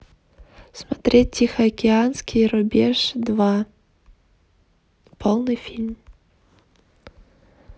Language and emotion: Russian, neutral